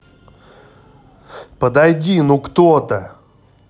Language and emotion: Russian, angry